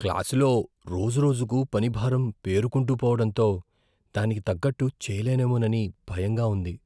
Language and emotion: Telugu, fearful